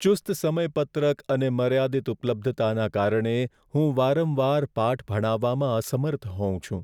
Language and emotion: Gujarati, sad